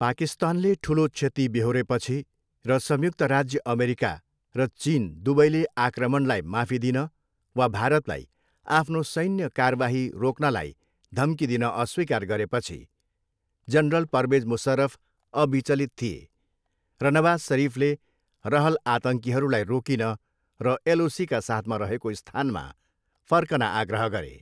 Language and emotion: Nepali, neutral